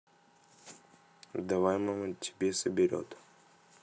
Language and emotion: Russian, neutral